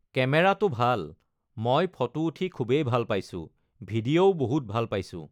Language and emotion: Assamese, neutral